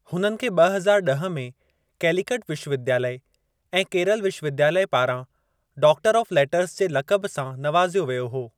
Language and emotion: Sindhi, neutral